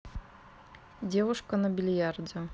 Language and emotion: Russian, neutral